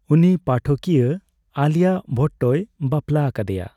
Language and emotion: Santali, neutral